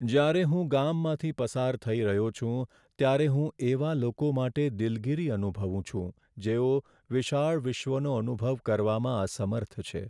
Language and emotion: Gujarati, sad